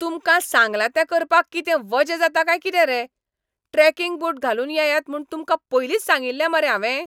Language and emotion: Goan Konkani, angry